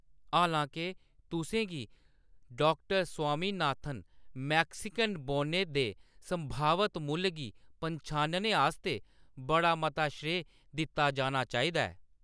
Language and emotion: Dogri, neutral